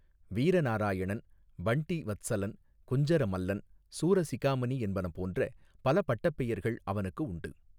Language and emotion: Tamil, neutral